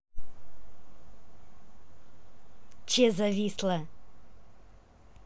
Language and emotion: Russian, angry